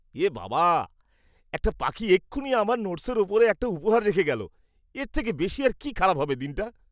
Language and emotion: Bengali, disgusted